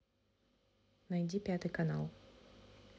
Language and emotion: Russian, neutral